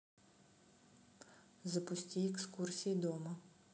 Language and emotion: Russian, neutral